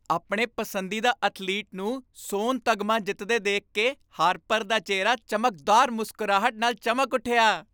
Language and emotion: Punjabi, happy